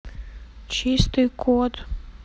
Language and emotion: Russian, neutral